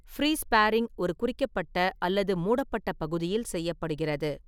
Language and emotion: Tamil, neutral